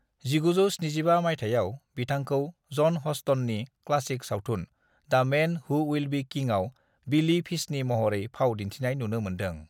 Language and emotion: Bodo, neutral